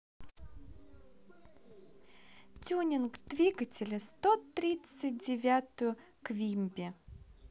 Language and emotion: Russian, positive